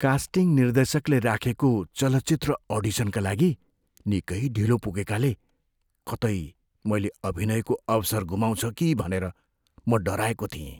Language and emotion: Nepali, fearful